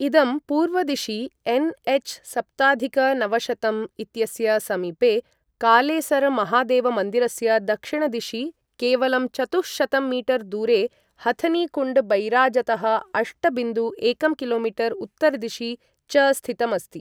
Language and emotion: Sanskrit, neutral